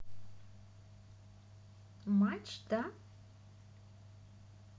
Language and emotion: Russian, positive